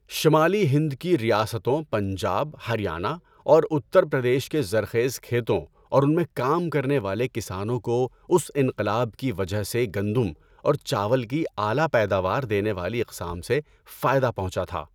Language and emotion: Urdu, neutral